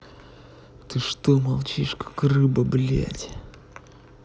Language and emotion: Russian, angry